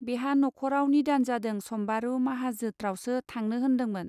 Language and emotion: Bodo, neutral